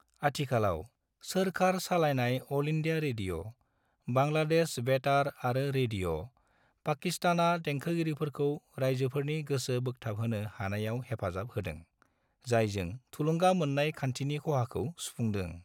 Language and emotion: Bodo, neutral